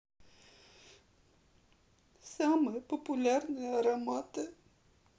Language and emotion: Russian, sad